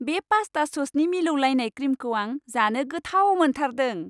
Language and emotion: Bodo, happy